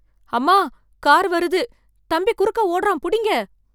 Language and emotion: Tamil, fearful